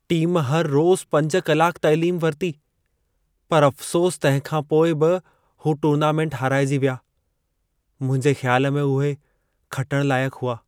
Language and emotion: Sindhi, sad